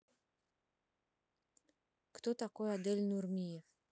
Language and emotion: Russian, neutral